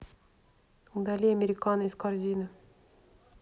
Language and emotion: Russian, neutral